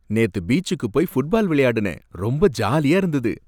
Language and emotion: Tamil, happy